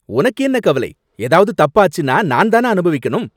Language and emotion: Tamil, angry